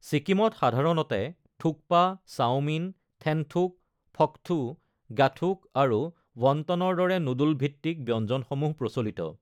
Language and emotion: Assamese, neutral